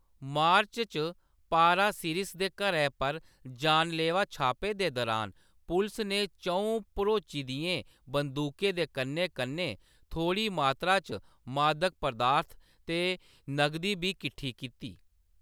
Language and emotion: Dogri, neutral